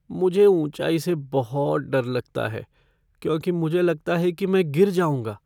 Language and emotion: Hindi, fearful